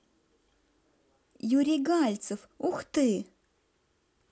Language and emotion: Russian, positive